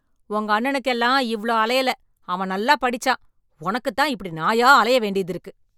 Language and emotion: Tamil, angry